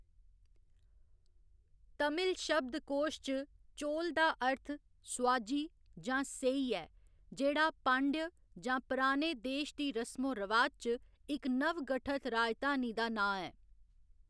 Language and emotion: Dogri, neutral